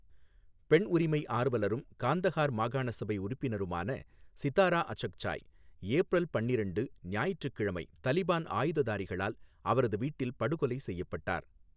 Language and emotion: Tamil, neutral